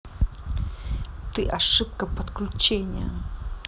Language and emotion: Russian, angry